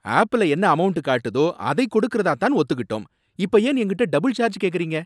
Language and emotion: Tamil, angry